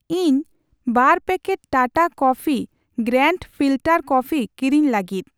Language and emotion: Santali, neutral